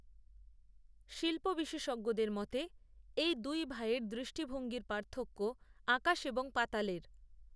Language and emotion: Bengali, neutral